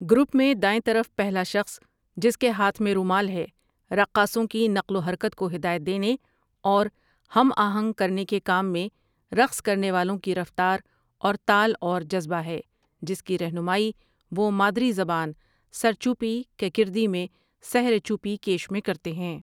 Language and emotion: Urdu, neutral